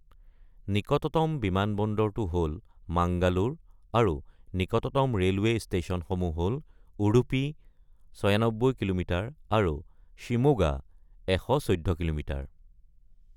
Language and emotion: Assamese, neutral